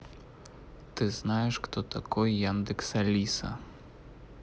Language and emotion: Russian, neutral